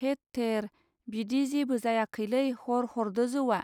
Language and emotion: Bodo, neutral